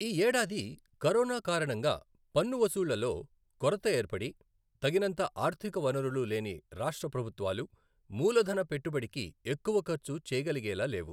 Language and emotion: Telugu, neutral